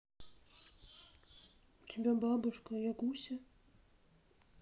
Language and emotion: Russian, sad